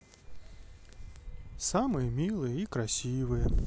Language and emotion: Russian, sad